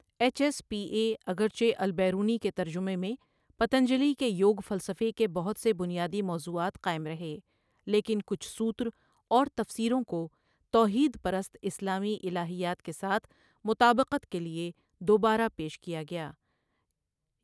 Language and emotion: Urdu, neutral